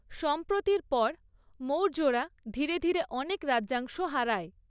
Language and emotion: Bengali, neutral